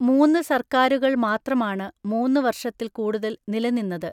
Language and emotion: Malayalam, neutral